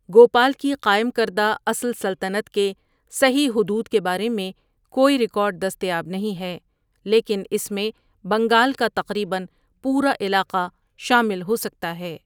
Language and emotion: Urdu, neutral